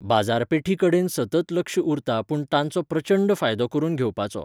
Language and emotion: Goan Konkani, neutral